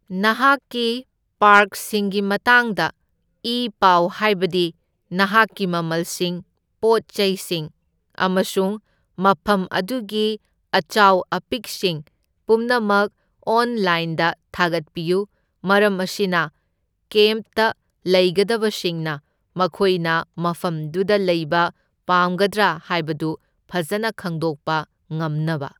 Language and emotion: Manipuri, neutral